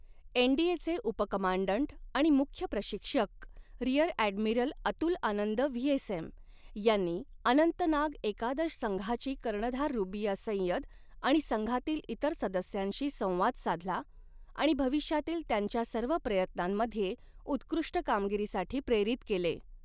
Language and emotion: Marathi, neutral